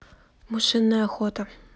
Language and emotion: Russian, neutral